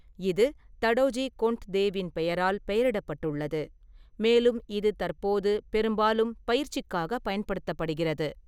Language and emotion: Tamil, neutral